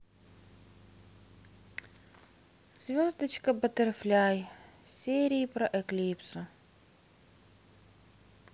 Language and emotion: Russian, sad